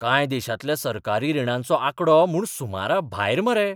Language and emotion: Goan Konkani, surprised